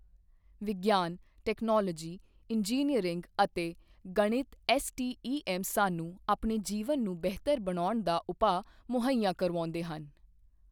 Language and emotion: Punjabi, neutral